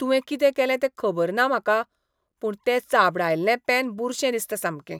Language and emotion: Goan Konkani, disgusted